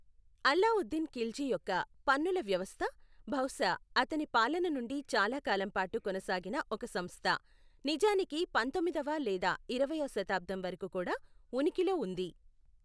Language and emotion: Telugu, neutral